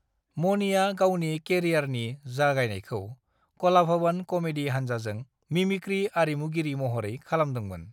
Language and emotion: Bodo, neutral